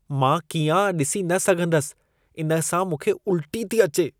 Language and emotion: Sindhi, disgusted